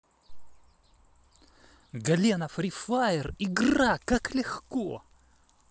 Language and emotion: Russian, positive